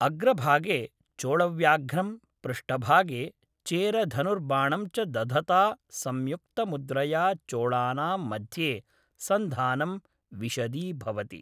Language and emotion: Sanskrit, neutral